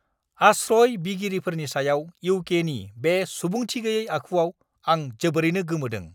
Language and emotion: Bodo, angry